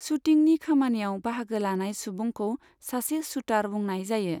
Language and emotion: Bodo, neutral